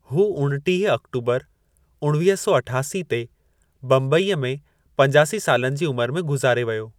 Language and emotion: Sindhi, neutral